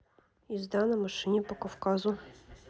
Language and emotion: Russian, neutral